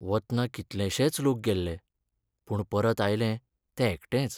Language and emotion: Goan Konkani, sad